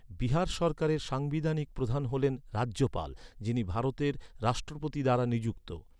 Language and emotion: Bengali, neutral